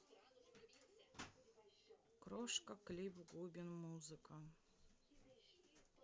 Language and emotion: Russian, sad